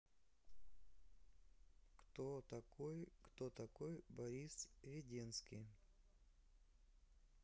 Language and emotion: Russian, neutral